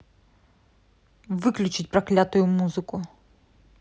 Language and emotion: Russian, angry